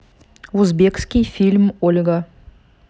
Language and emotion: Russian, neutral